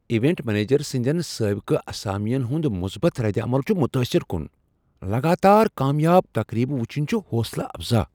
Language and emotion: Kashmiri, surprised